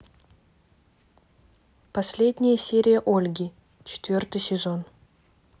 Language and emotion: Russian, neutral